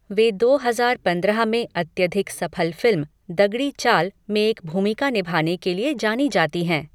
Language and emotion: Hindi, neutral